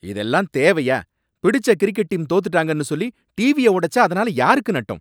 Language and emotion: Tamil, angry